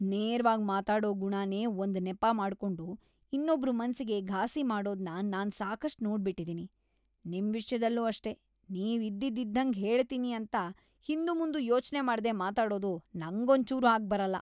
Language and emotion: Kannada, disgusted